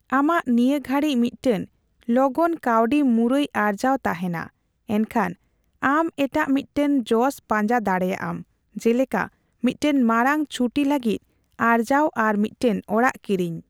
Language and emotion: Santali, neutral